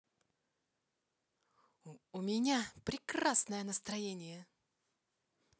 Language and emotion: Russian, positive